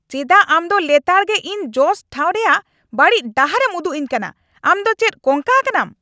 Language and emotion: Santali, angry